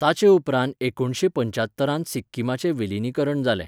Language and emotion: Goan Konkani, neutral